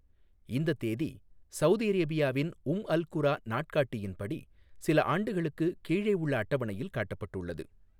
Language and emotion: Tamil, neutral